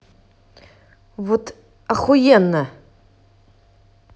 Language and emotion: Russian, angry